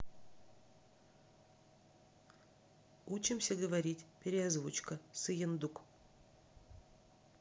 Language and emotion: Russian, neutral